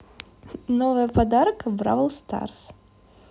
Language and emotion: Russian, positive